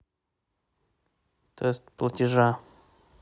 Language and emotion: Russian, neutral